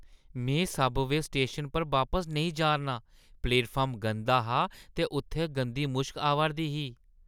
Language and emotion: Dogri, disgusted